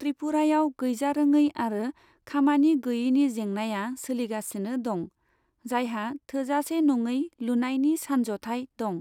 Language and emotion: Bodo, neutral